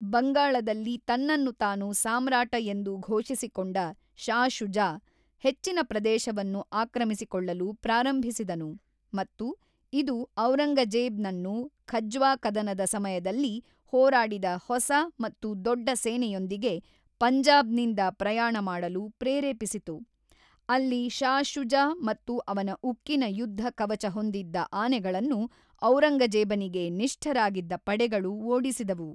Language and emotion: Kannada, neutral